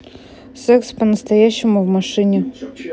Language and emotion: Russian, neutral